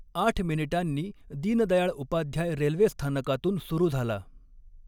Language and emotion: Marathi, neutral